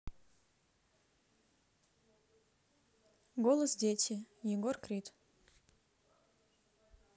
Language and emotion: Russian, neutral